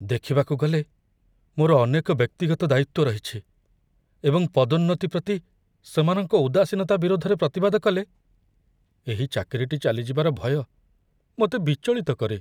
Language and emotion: Odia, fearful